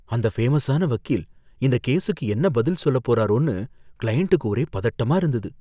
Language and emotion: Tamil, fearful